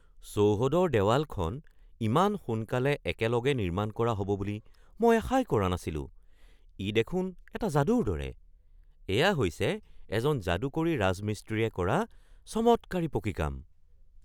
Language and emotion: Assamese, surprised